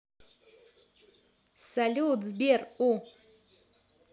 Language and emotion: Russian, positive